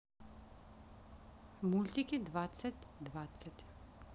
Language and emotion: Russian, neutral